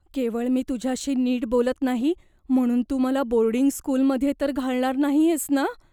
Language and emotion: Marathi, fearful